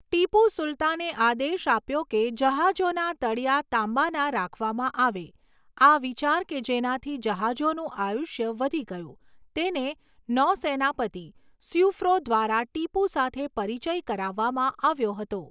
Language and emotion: Gujarati, neutral